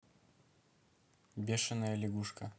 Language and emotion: Russian, neutral